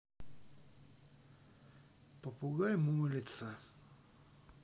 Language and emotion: Russian, sad